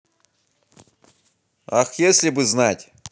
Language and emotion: Russian, positive